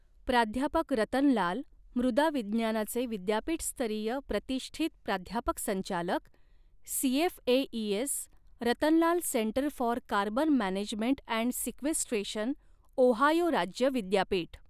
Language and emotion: Marathi, neutral